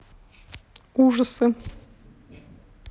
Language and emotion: Russian, neutral